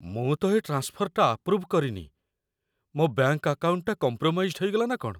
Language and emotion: Odia, fearful